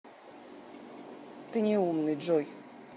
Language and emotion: Russian, neutral